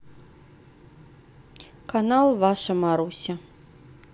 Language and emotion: Russian, neutral